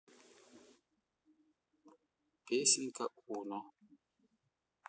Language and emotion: Russian, neutral